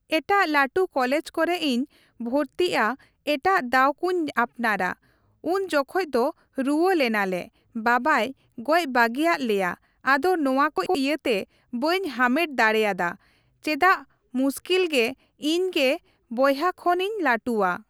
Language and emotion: Santali, neutral